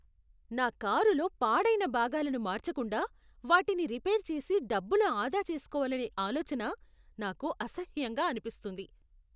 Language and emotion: Telugu, disgusted